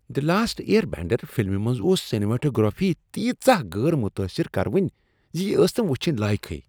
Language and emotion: Kashmiri, disgusted